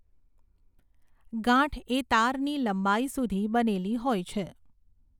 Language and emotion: Gujarati, neutral